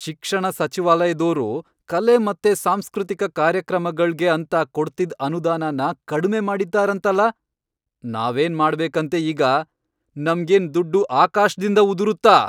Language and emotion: Kannada, angry